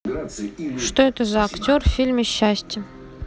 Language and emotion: Russian, neutral